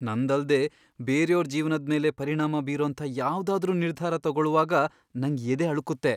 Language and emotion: Kannada, fearful